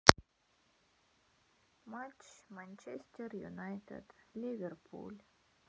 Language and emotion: Russian, sad